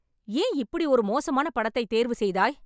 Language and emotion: Tamil, angry